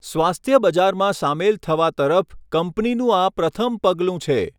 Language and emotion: Gujarati, neutral